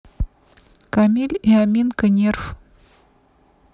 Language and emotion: Russian, neutral